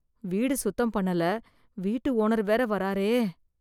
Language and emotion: Tamil, fearful